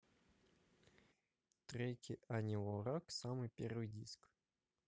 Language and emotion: Russian, neutral